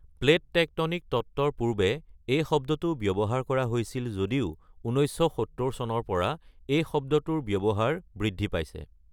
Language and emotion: Assamese, neutral